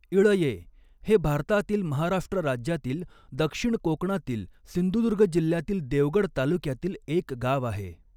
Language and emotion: Marathi, neutral